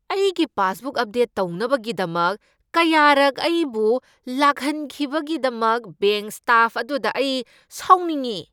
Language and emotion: Manipuri, angry